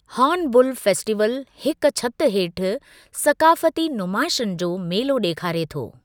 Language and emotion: Sindhi, neutral